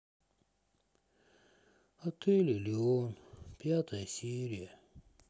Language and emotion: Russian, sad